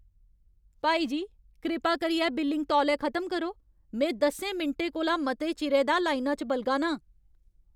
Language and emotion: Dogri, angry